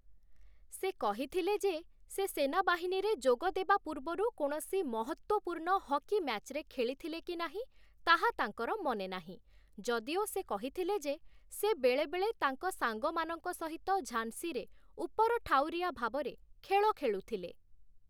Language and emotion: Odia, neutral